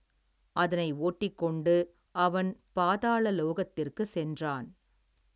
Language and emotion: Tamil, neutral